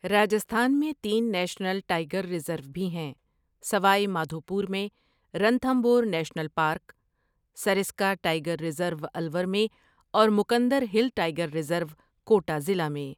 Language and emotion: Urdu, neutral